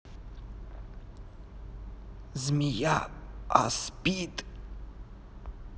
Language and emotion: Russian, neutral